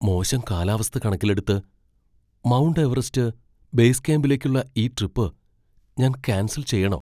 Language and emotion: Malayalam, fearful